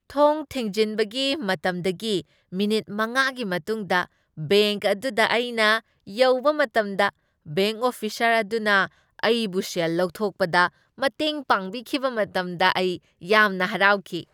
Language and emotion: Manipuri, happy